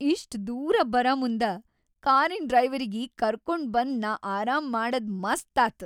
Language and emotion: Kannada, happy